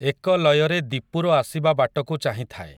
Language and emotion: Odia, neutral